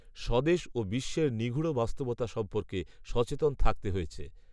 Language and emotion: Bengali, neutral